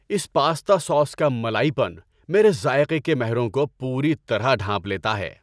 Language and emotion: Urdu, happy